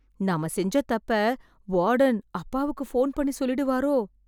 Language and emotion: Tamil, fearful